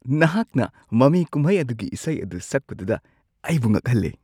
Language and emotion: Manipuri, surprised